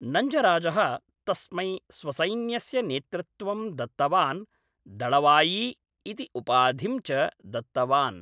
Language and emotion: Sanskrit, neutral